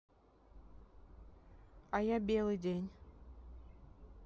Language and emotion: Russian, neutral